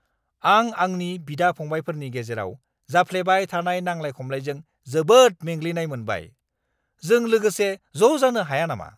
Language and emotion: Bodo, angry